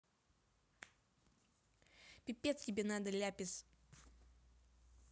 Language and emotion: Russian, angry